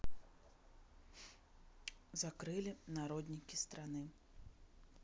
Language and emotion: Russian, sad